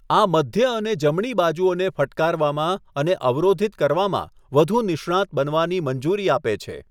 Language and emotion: Gujarati, neutral